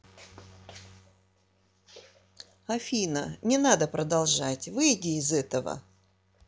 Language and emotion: Russian, neutral